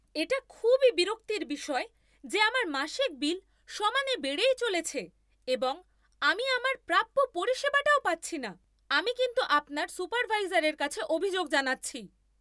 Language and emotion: Bengali, angry